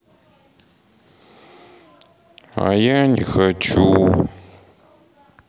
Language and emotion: Russian, sad